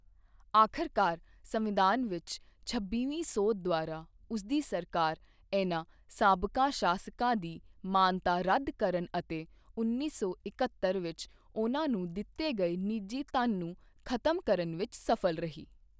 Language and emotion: Punjabi, neutral